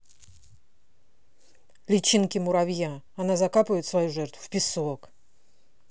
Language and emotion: Russian, angry